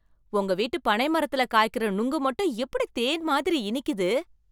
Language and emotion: Tamil, surprised